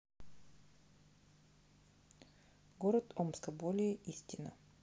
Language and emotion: Russian, neutral